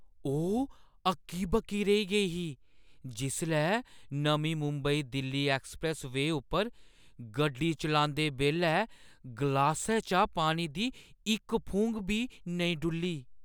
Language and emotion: Dogri, surprised